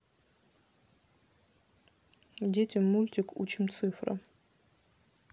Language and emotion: Russian, neutral